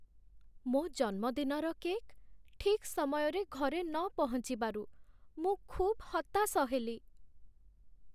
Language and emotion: Odia, sad